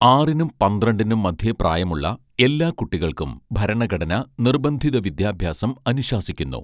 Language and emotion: Malayalam, neutral